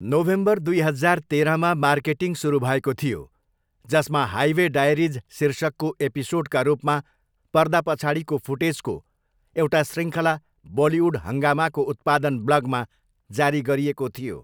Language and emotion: Nepali, neutral